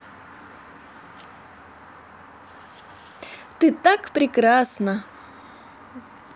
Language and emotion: Russian, positive